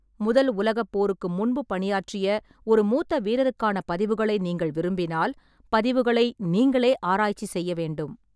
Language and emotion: Tamil, neutral